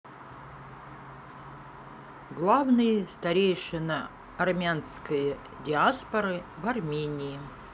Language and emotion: Russian, neutral